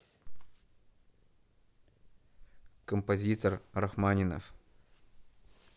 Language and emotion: Russian, neutral